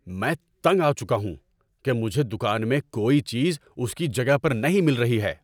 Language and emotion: Urdu, angry